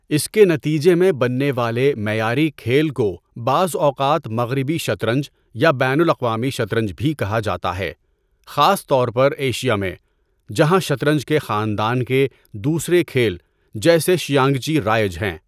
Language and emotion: Urdu, neutral